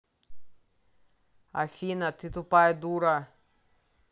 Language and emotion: Russian, angry